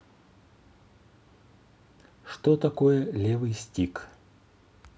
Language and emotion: Russian, neutral